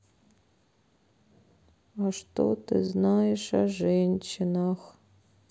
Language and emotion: Russian, sad